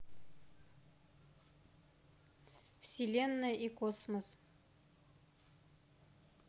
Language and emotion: Russian, neutral